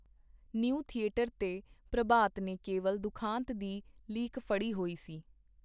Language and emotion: Punjabi, neutral